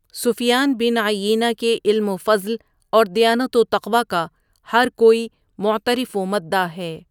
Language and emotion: Urdu, neutral